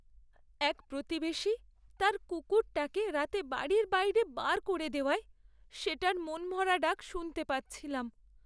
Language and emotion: Bengali, sad